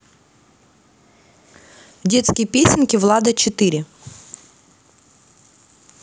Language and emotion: Russian, neutral